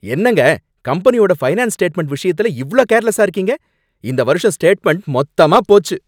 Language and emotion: Tamil, angry